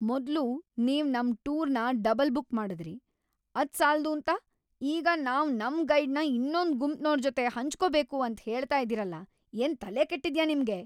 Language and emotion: Kannada, angry